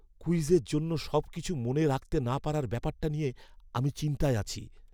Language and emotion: Bengali, fearful